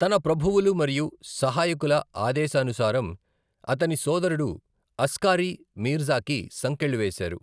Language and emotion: Telugu, neutral